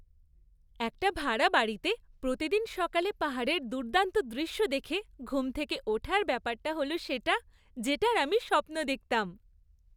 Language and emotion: Bengali, happy